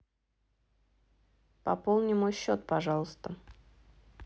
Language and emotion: Russian, neutral